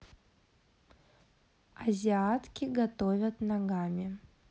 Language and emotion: Russian, neutral